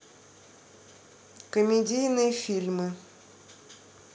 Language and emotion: Russian, neutral